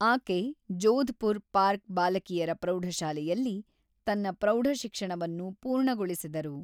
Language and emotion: Kannada, neutral